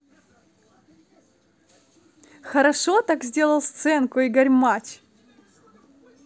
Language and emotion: Russian, positive